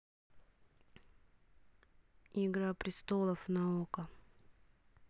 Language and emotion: Russian, neutral